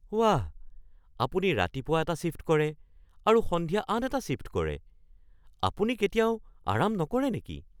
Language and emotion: Assamese, surprised